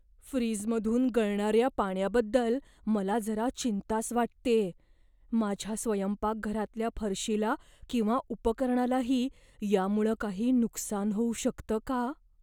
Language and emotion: Marathi, fearful